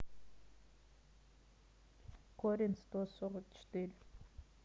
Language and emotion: Russian, neutral